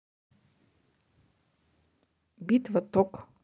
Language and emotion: Russian, neutral